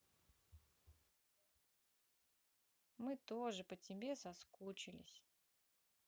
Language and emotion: Russian, neutral